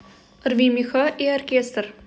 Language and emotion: Russian, neutral